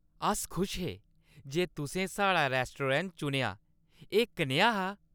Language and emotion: Dogri, happy